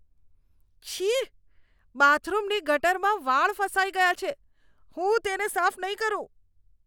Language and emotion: Gujarati, disgusted